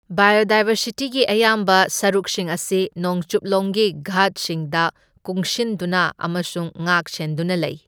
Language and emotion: Manipuri, neutral